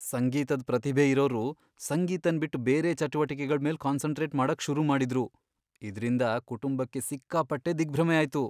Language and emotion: Kannada, fearful